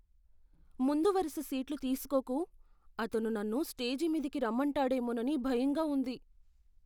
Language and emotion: Telugu, fearful